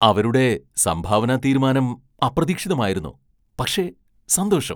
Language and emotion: Malayalam, surprised